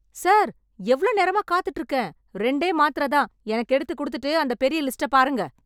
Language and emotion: Tamil, angry